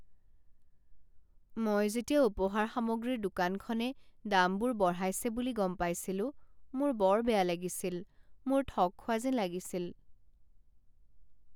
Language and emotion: Assamese, sad